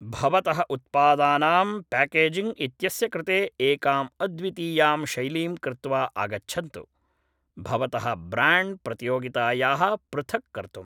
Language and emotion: Sanskrit, neutral